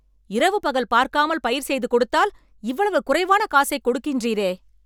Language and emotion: Tamil, angry